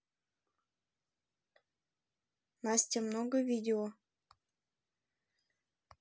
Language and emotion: Russian, neutral